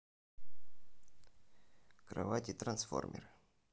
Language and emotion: Russian, neutral